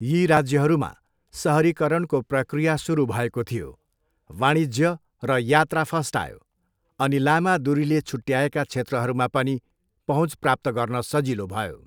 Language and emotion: Nepali, neutral